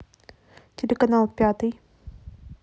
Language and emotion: Russian, neutral